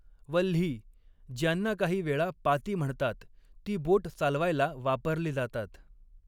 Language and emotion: Marathi, neutral